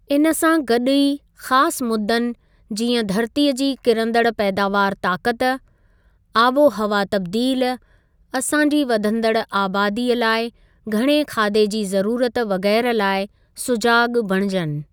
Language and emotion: Sindhi, neutral